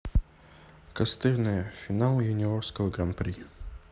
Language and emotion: Russian, neutral